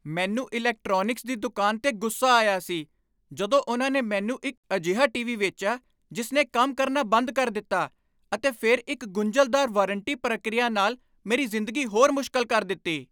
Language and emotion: Punjabi, angry